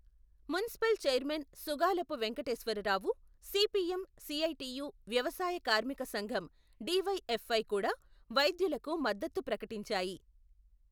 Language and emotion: Telugu, neutral